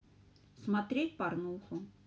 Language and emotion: Russian, neutral